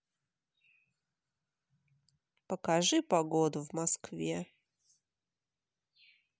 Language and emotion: Russian, sad